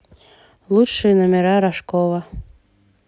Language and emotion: Russian, neutral